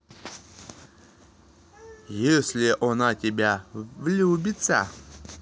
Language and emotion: Russian, neutral